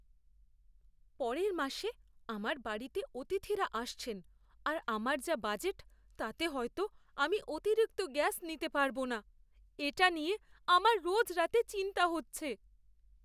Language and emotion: Bengali, fearful